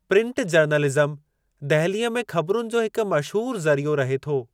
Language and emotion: Sindhi, neutral